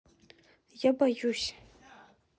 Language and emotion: Russian, sad